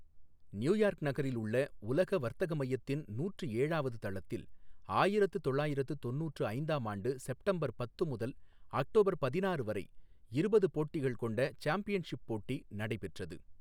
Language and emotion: Tamil, neutral